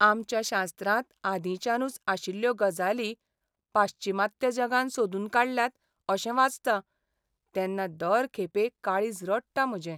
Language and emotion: Goan Konkani, sad